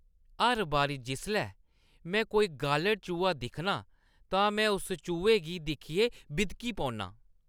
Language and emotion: Dogri, disgusted